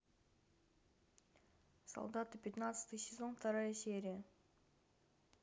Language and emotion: Russian, neutral